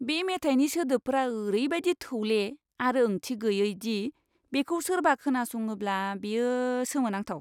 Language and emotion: Bodo, disgusted